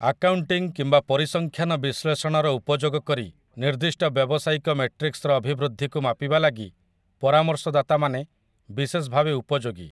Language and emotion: Odia, neutral